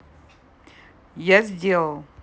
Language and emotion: Russian, neutral